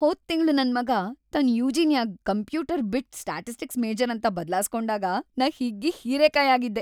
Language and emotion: Kannada, happy